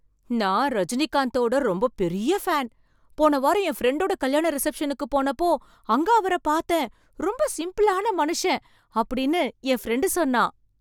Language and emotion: Tamil, surprised